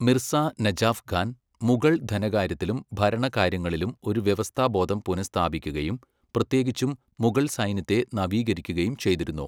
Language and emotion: Malayalam, neutral